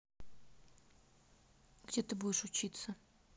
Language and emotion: Russian, neutral